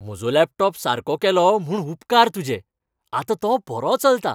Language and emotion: Goan Konkani, happy